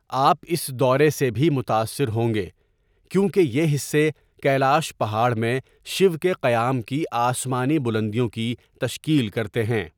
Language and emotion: Urdu, neutral